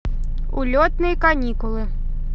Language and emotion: Russian, positive